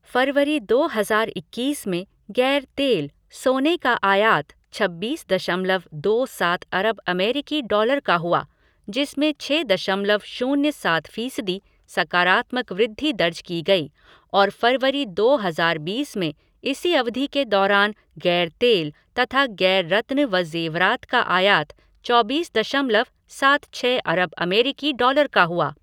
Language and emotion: Hindi, neutral